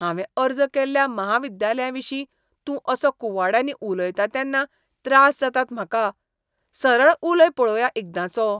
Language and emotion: Goan Konkani, disgusted